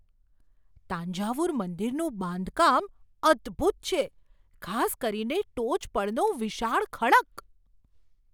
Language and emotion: Gujarati, surprised